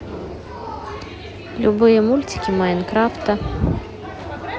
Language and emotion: Russian, neutral